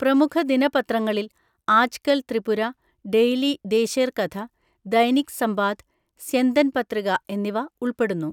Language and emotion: Malayalam, neutral